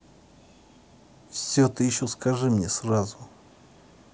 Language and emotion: Russian, angry